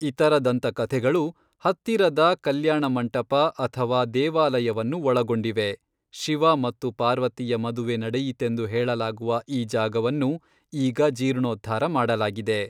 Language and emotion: Kannada, neutral